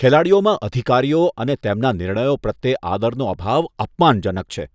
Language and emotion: Gujarati, disgusted